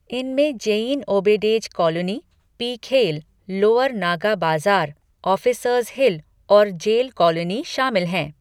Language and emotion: Hindi, neutral